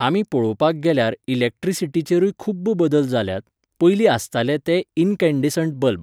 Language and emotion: Goan Konkani, neutral